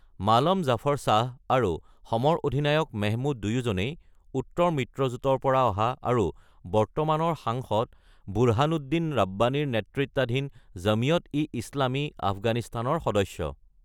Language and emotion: Assamese, neutral